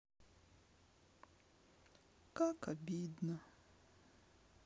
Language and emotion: Russian, sad